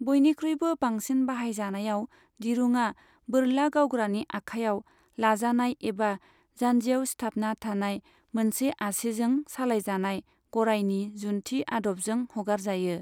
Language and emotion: Bodo, neutral